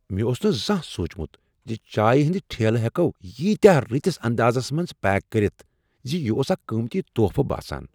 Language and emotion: Kashmiri, surprised